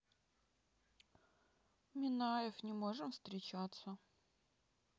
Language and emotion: Russian, sad